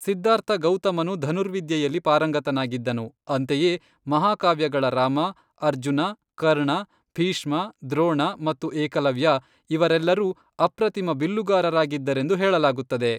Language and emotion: Kannada, neutral